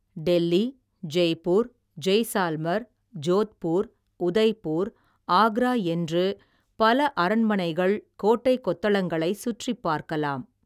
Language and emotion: Tamil, neutral